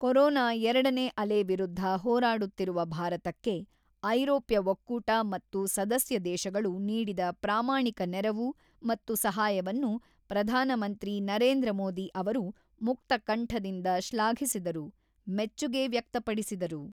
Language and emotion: Kannada, neutral